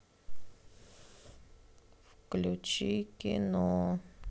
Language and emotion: Russian, sad